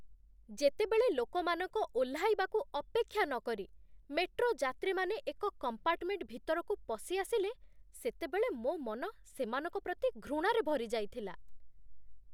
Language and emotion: Odia, disgusted